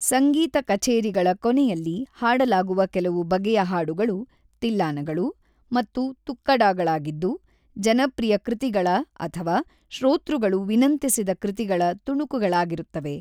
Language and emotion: Kannada, neutral